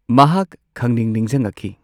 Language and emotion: Manipuri, neutral